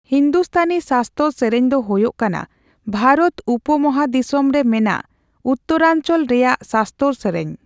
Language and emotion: Santali, neutral